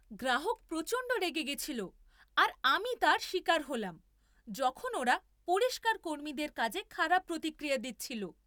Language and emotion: Bengali, angry